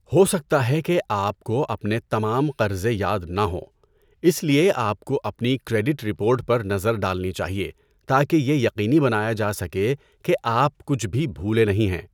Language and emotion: Urdu, neutral